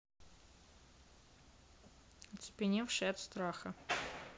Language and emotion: Russian, neutral